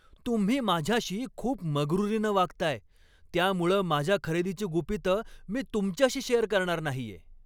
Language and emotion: Marathi, angry